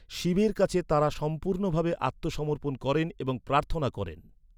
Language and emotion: Bengali, neutral